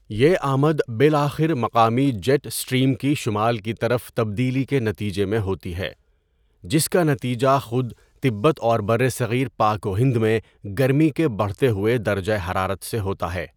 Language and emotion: Urdu, neutral